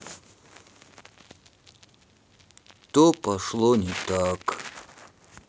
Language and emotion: Russian, sad